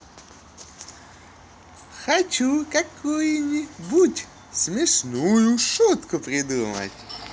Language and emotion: Russian, positive